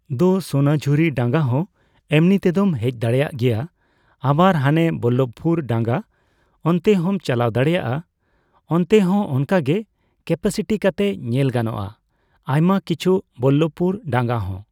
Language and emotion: Santali, neutral